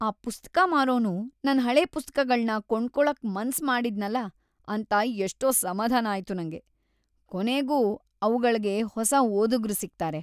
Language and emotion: Kannada, happy